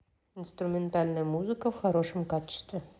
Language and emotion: Russian, neutral